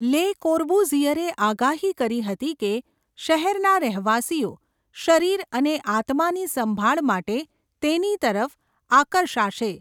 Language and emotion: Gujarati, neutral